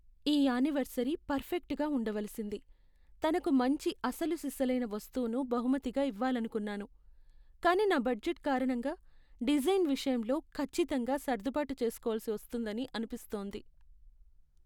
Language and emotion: Telugu, sad